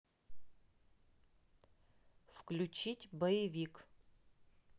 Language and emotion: Russian, neutral